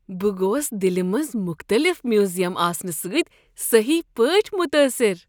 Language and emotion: Kashmiri, surprised